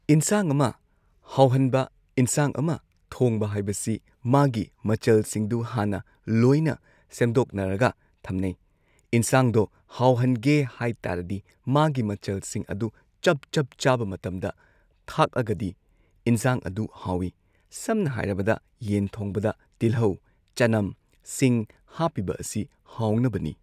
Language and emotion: Manipuri, neutral